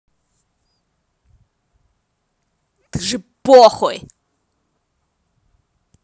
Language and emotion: Russian, angry